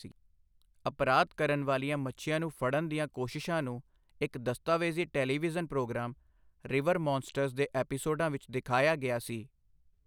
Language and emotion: Punjabi, neutral